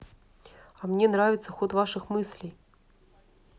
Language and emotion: Russian, neutral